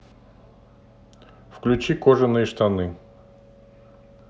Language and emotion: Russian, neutral